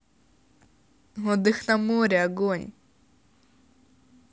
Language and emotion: Russian, positive